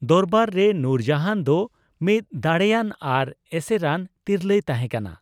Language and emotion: Santali, neutral